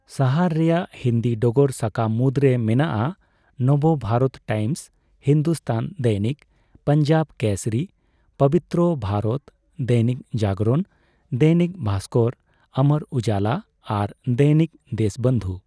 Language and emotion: Santali, neutral